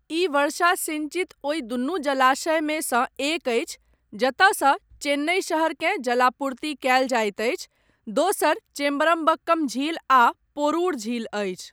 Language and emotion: Maithili, neutral